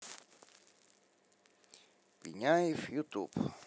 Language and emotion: Russian, neutral